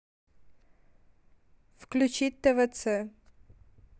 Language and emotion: Russian, neutral